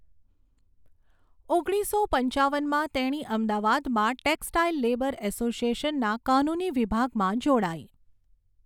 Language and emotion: Gujarati, neutral